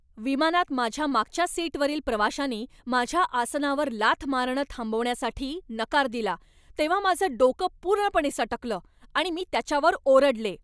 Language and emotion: Marathi, angry